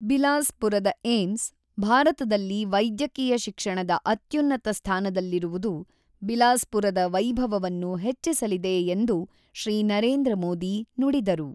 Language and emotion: Kannada, neutral